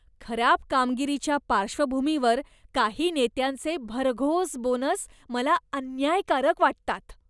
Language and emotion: Marathi, disgusted